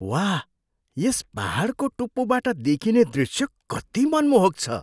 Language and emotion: Nepali, surprised